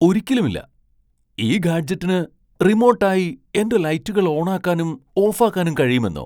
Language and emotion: Malayalam, surprised